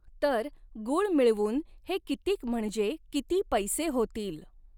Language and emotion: Marathi, neutral